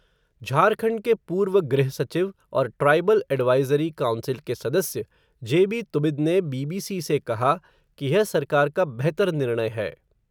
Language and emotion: Hindi, neutral